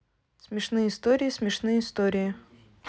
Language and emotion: Russian, neutral